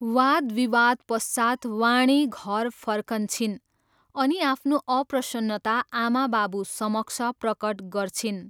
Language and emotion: Nepali, neutral